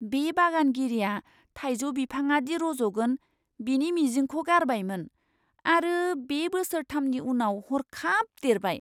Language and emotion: Bodo, surprised